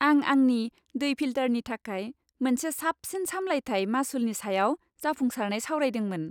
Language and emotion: Bodo, happy